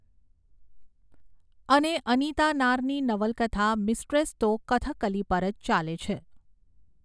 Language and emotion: Gujarati, neutral